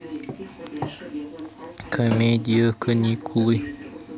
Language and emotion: Russian, neutral